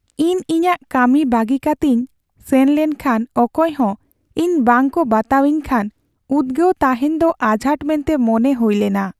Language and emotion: Santali, sad